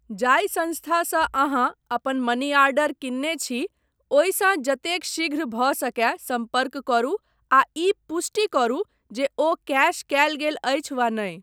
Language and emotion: Maithili, neutral